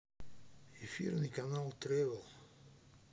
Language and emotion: Russian, neutral